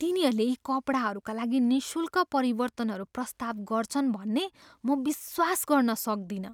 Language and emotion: Nepali, surprised